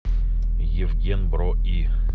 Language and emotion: Russian, neutral